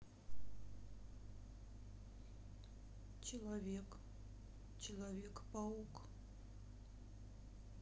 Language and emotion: Russian, sad